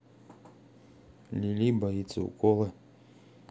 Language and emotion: Russian, neutral